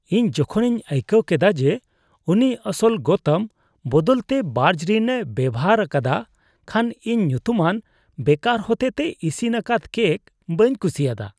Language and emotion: Santali, disgusted